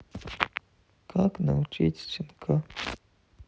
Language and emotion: Russian, sad